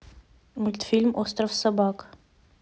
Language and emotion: Russian, neutral